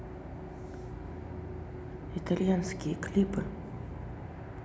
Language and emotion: Russian, neutral